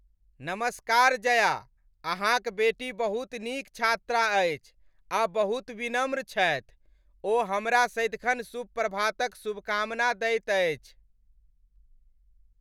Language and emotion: Maithili, happy